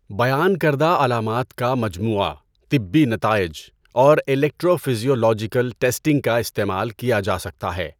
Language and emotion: Urdu, neutral